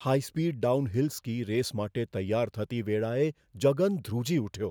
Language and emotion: Gujarati, fearful